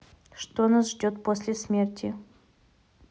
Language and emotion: Russian, neutral